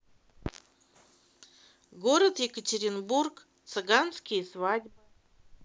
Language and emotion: Russian, neutral